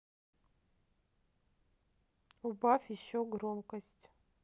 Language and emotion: Russian, neutral